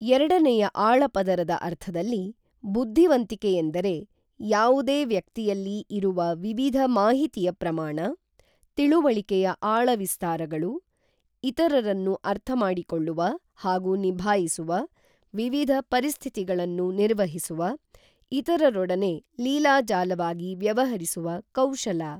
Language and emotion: Kannada, neutral